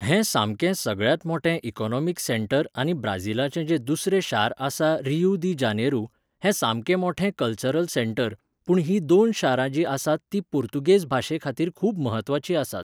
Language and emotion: Goan Konkani, neutral